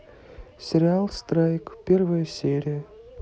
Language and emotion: Russian, neutral